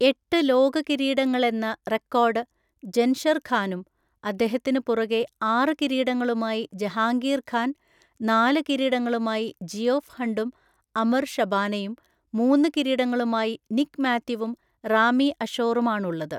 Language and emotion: Malayalam, neutral